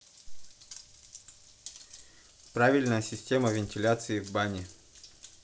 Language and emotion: Russian, neutral